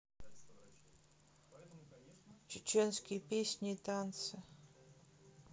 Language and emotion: Russian, sad